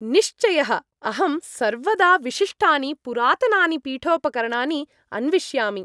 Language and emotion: Sanskrit, happy